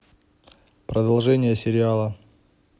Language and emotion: Russian, neutral